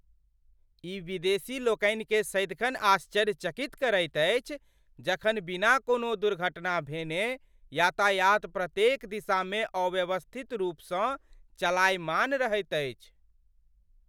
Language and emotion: Maithili, surprised